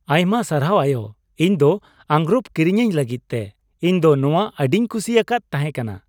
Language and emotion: Santali, happy